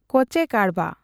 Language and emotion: Santali, neutral